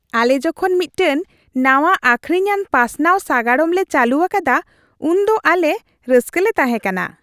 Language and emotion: Santali, happy